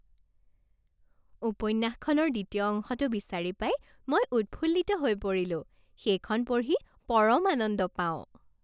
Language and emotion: Assamese, happy